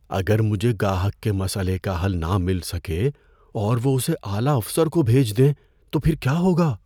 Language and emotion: Urdu, fearful